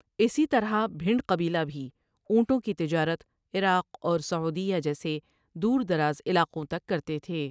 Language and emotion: Urdu, neutral